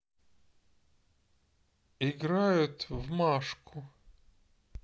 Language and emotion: Russian, sad